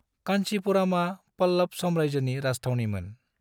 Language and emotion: Bodo, neutral